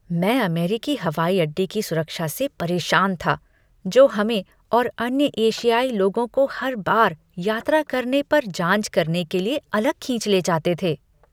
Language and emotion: Hindi, disgusted